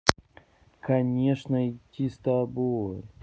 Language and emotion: Russian, neutral